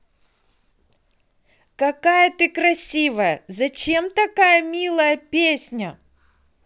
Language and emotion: Russian, positive